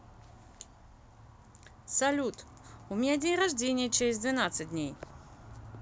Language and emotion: Russian, positive